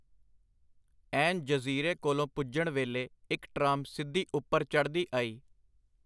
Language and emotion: Punjabi, neutral